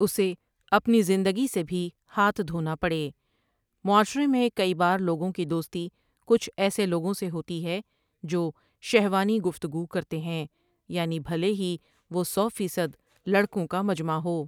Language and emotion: Urdu, neutral